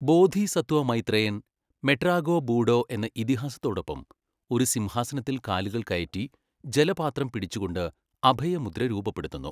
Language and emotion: Malayalam, neutral